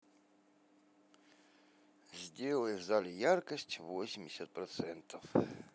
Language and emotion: Russian, neutral